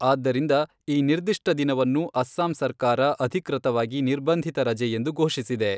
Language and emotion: Kannada, neutral